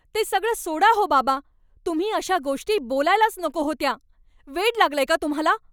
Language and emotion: Marathi, angry